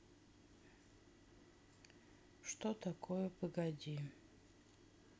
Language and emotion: Russian, neutral